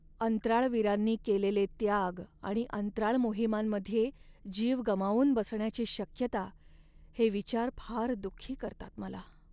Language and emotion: Marathi, sad